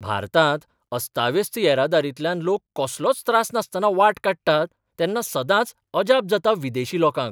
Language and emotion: Goan Konkani, surprised